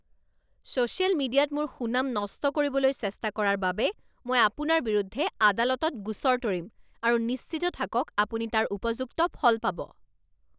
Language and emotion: Assamese, angry